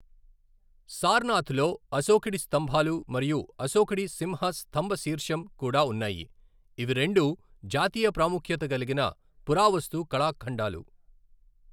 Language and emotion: Telugu, neutral